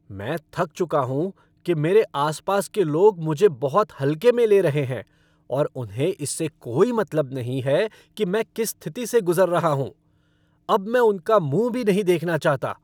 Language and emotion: Hindi, angry